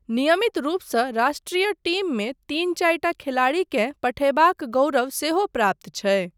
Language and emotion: Maithili, neutral